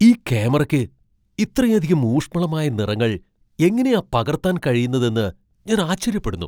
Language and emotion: Malayalam, surprised